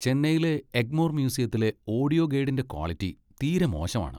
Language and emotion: Malayalam, disgusted